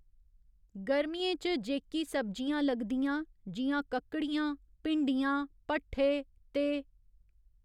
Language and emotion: Dogri, neutral